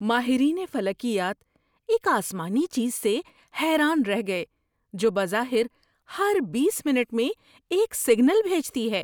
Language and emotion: Urdu, surprised